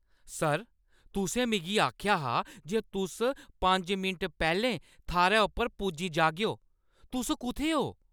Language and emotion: Dogri, angry